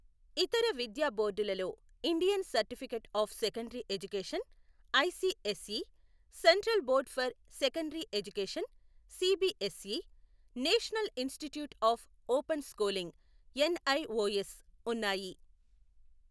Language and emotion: Telugu, neutral